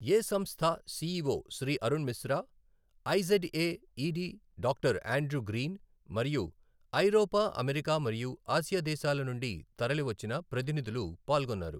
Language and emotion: Telugu, neutral